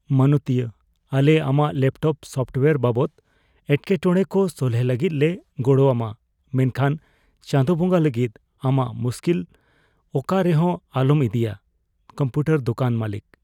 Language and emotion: Santali, fearful